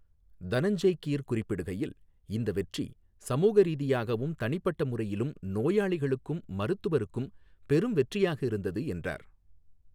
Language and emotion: Tamil, neutral